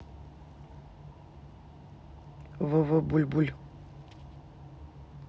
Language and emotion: Russian, neutral